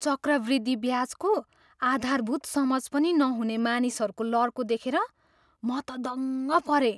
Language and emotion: Nepali, surprised